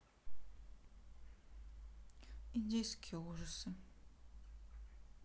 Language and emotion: Russian, sad